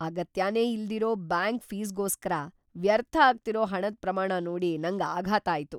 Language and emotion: Kannada, surprised